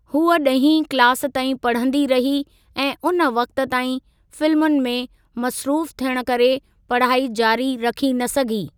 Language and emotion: Sindhi, neutral